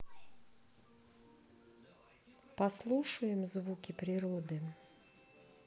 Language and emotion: Russian, sad